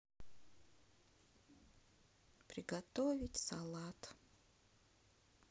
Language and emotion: Russian, sad